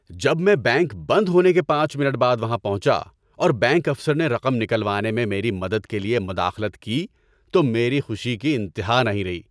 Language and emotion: Urdu, happy